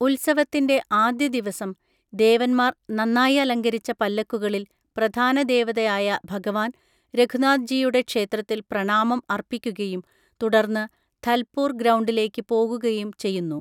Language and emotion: Malayalam, neutral